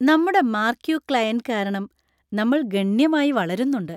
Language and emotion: Malayalam, happy